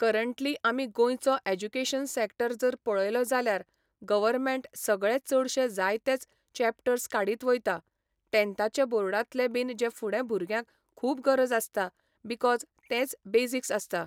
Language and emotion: Goan Konkani, neutral